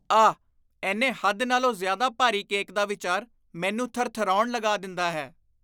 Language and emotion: Punjabi, disgusted